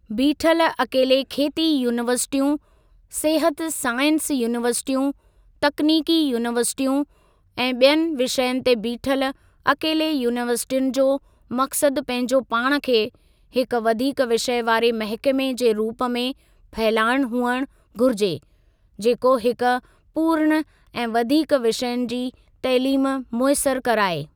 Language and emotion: Sindhi, neutral